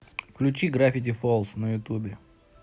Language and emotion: Russian, neutral